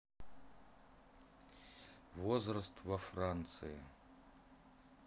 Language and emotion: Russian, neutral